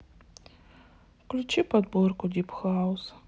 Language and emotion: Russian, sad